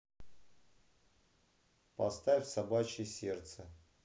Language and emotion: Russian, neutral